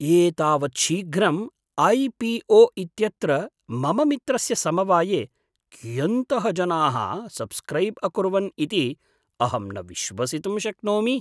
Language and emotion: Sanskrit, surprised